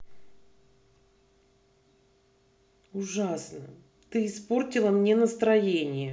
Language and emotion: Russian, angry